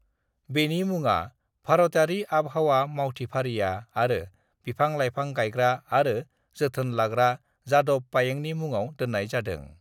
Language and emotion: Bodo, neutral